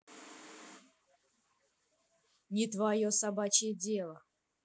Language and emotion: Russian, angry